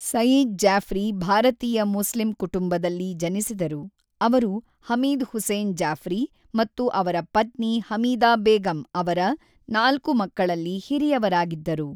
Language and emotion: Kannada, neutral